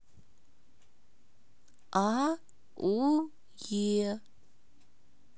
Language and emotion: Russian, neutral